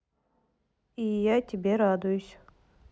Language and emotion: Russian, neutral